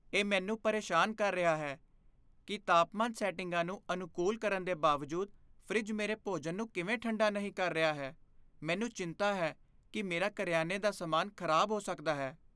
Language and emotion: Punjabi, fearful